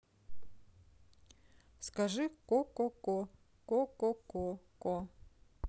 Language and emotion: Russian, neutral